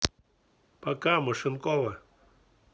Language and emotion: Russian, neutral